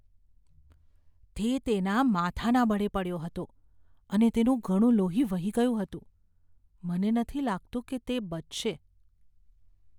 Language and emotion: Gujarati, fearful